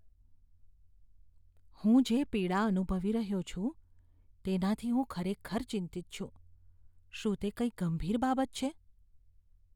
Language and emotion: Gujarati, fearful